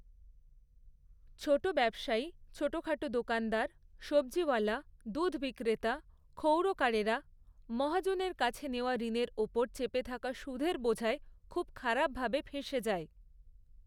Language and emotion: Bengali, neutral